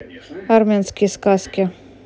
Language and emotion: Russian, neutral